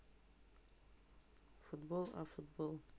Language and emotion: Russian, neutral